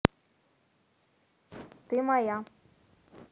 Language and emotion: Russian, neutral